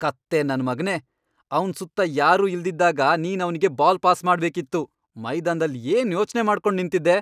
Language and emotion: Kannada, angry